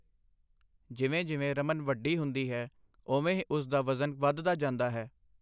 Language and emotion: Punjabi, neutral